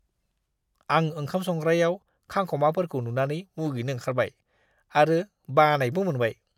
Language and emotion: Bodo, disgusted